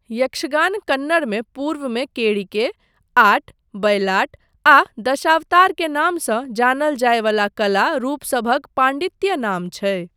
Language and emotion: Maithili, neutral